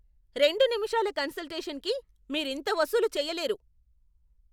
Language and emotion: Telugu, angry